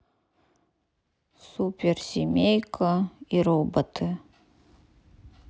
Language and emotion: Russian, sad